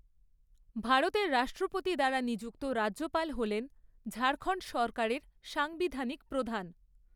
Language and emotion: Bengali, neutral